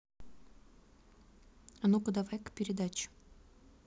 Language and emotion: Russian, neutral